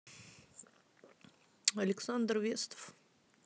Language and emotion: Russian, neutral